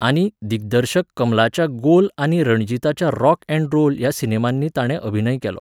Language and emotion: Goan Konkani, neutral